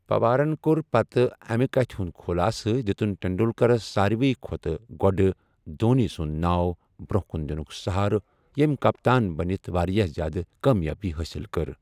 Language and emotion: Kashmiri, neutral